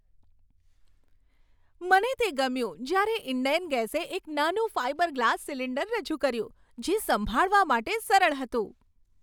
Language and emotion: Gujarati, happy